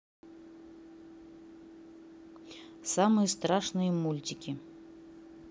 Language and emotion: Russian, neutral